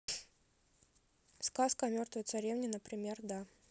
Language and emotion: Russian, neutral